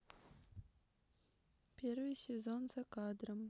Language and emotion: Russian, neutral